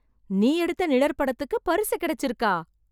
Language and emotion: Tamil, surprised